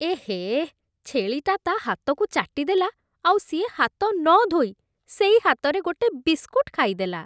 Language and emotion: Odia, disgusted